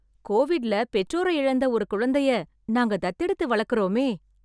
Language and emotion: Tamil, happy